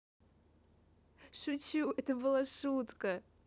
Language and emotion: Russian, positive